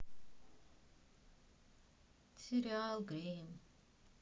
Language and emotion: Russian, sad